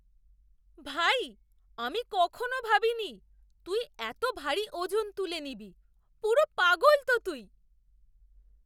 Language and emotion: Bengali, surprised